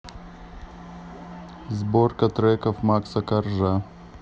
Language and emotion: Russian, neutral